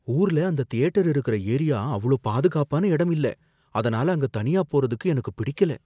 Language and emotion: Tamil, fearful